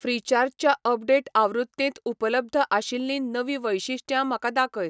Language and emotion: Goan Konkani, neutral